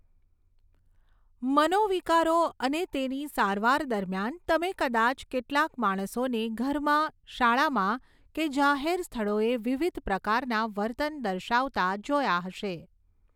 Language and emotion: Gujarati, neutral